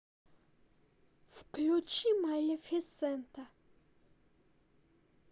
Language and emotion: Russian, neutral